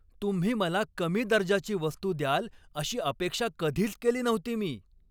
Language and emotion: Marathi, angry